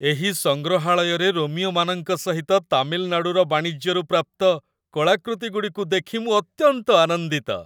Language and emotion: Odia, happy